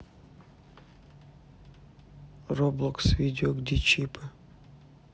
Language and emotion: Russian, neutral